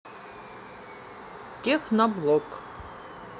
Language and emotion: Russian, neutral